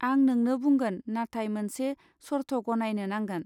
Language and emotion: Bodo, neutral